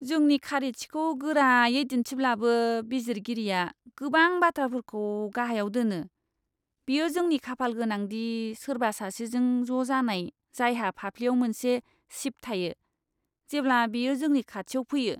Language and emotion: Bodo, disgusted